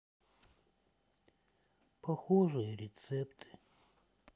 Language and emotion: Russian, sad